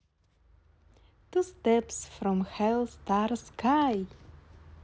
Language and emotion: Russian, positive